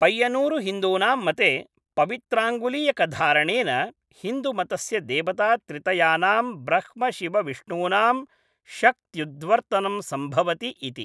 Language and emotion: Sanskrit, neutral